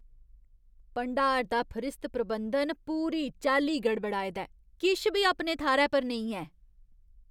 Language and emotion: Dogri, disgusted